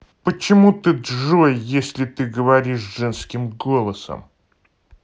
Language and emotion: Russian, angry